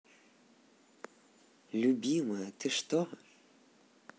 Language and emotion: Russian, positive